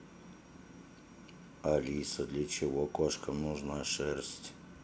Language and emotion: Russian, neutral